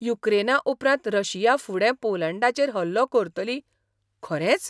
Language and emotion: Goan Konkani, surprised